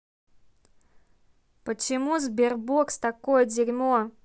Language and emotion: Russian, angry